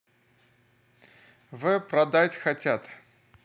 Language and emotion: Russian, neutral